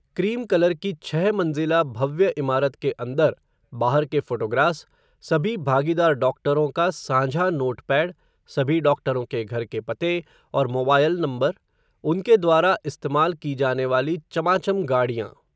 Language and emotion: Hindi, neutral